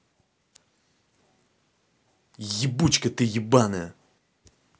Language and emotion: Russian, angry